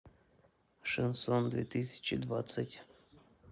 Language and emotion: Russian, neutral